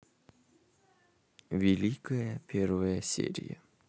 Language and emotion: Russian, neutral